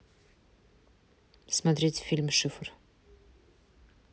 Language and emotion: Russian, neutral